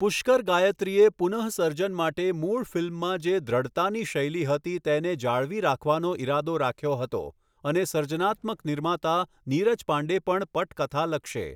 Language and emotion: Gujarati, neutral